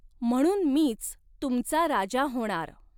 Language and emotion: Marathi, neutral